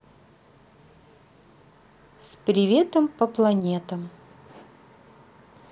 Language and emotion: Russian, positive